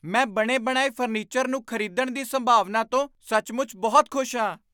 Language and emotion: Punjabi, surprised